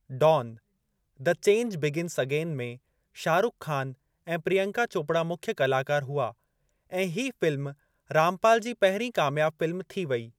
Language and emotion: Sindhi, neutral